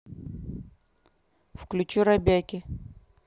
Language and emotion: Russian, neutral